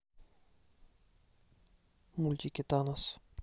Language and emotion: Russian, neutral